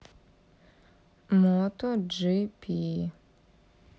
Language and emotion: Russian, neutral